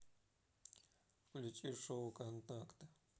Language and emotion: Russian, neutral